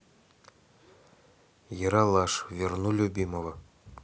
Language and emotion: Russian, neutral